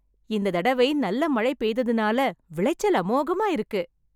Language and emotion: Tamil, happy